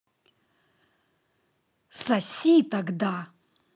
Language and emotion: Russian, angry